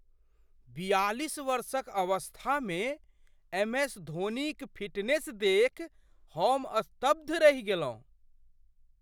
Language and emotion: Maithili, surprised